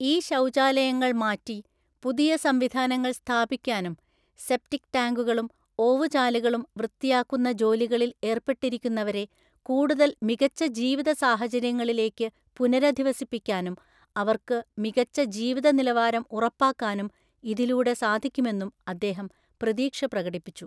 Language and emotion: Malayalam, neutral